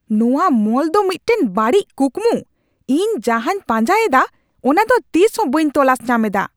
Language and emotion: Santali, angry